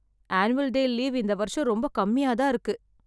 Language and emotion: Tamil, sad